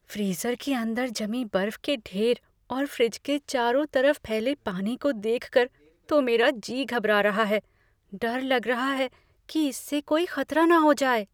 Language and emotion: Hindi, fearful